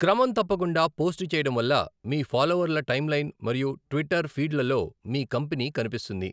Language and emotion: Telugu, neutral